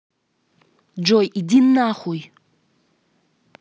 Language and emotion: Russian, angry